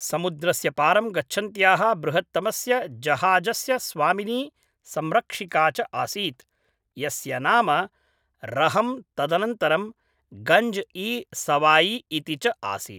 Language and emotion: Sanskrit, neutral